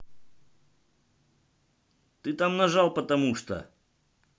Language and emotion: Russian, angry